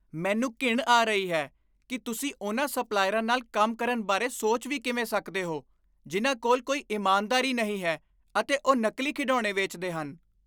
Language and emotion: Punjabi, disgusted